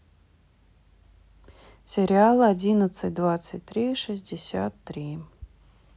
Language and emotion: Russian, neutral